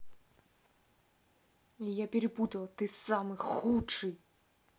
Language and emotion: Russian, angry